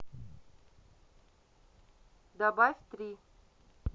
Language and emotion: Russian, neutral